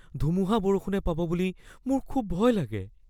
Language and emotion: Assamese, fearful